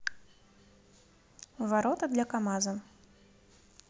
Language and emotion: Russian, neutral